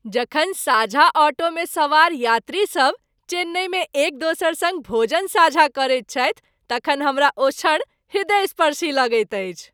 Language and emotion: Maithili, happy